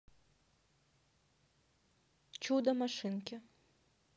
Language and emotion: Russian, neutral